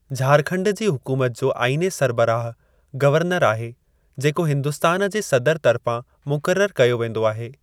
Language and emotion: Sindhi, neutral